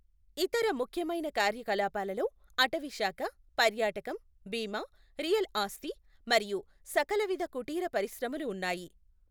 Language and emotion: Telugu, neutral